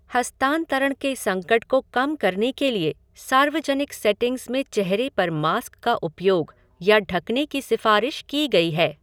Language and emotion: Hindi, neutral